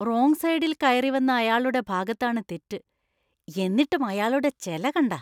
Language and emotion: Malayalam, disgusted